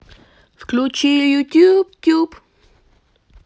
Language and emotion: Russian, positive